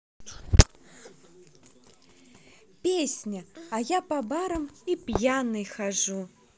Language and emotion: Russian, positive